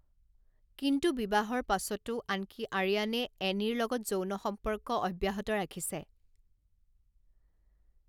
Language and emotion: Assamese, neutral